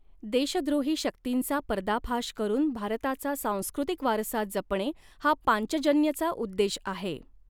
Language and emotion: Marathi, neutral